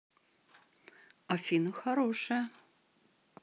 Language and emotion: Russian, positive